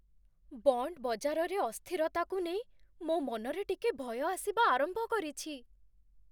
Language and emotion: Odia, fearful